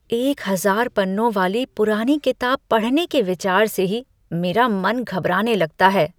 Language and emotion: Hindi, disgusted